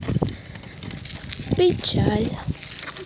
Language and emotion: Russian, sad